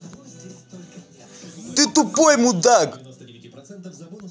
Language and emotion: Russian, angry